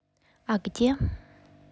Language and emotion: Russian, neutral